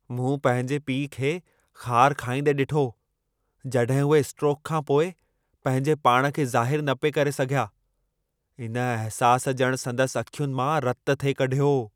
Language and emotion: Sindhi, angry